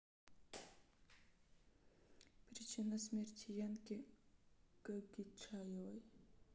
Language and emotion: Russian, sad